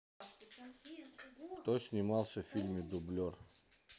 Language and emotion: Russian, neutral